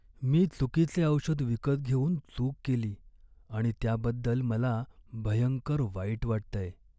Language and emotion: Marathi, sad